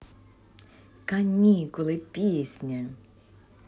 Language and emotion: Russian, positive